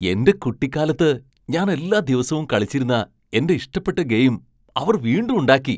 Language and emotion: Malayalam, surprised